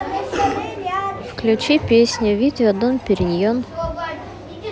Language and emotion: Russian, neutral